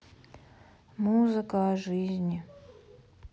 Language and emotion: Russian, sad